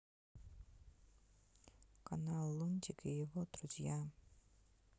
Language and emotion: Russian, neutral